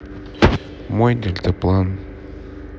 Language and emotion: Russian, neutral